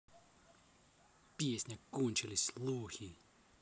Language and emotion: Russian, angry